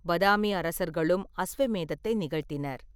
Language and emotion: Tamil, neutral